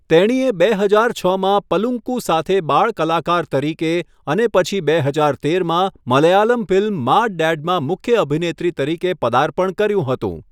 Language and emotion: Gujarati, neutral